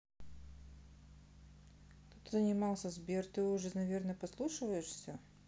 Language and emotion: Russian, neutral